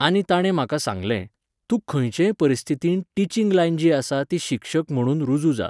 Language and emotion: Goan Konkani, neutral